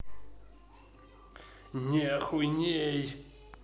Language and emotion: Russian, angry